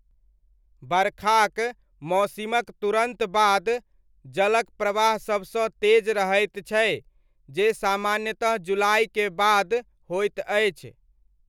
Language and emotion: Maithili, neutral